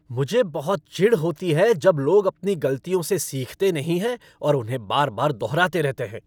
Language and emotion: Hindi, angry